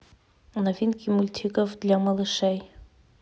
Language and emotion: Russian, neutral